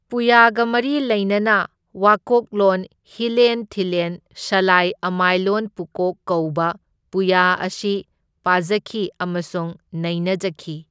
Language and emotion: Manipuri, neutral